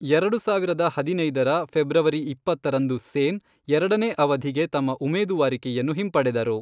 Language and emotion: Kannada, neutral